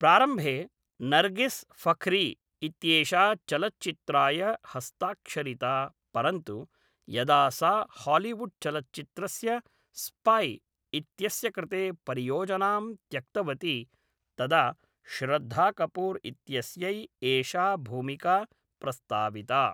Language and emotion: Sanskrit, neutral